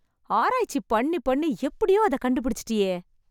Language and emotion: Tamil, happy